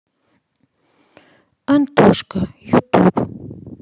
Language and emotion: Russian, neutral